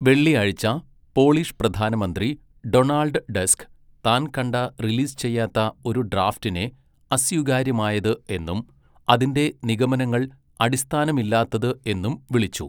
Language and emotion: Malayalam, neutral